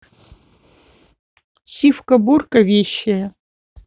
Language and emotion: Russian, neutral